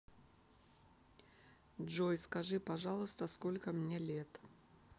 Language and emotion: Russian, neutral